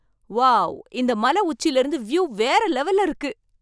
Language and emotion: Tamil, surprised